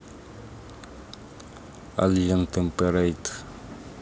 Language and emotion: Russian, neutral